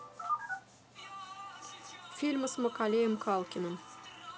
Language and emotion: Russian, neutral